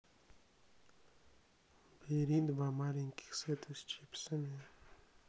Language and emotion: Russian, neutral